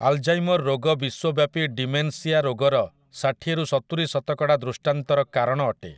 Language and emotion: Odia, neutral